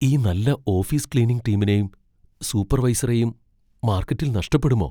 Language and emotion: Malayalam, fearful